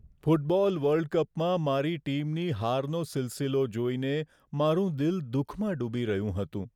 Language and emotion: Gujarati, sad